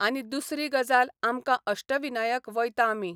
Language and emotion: Goan Konkani, neutral